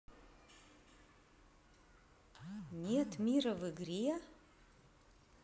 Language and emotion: Russian, neutral